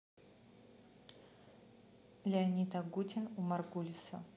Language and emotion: Russian, neutral